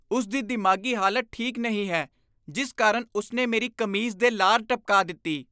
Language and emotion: Punjabi, disgusted